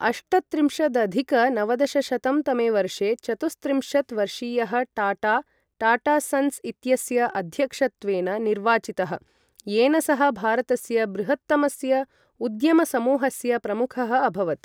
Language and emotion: Sanskrit, neutral